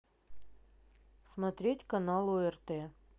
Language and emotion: Russian, neutral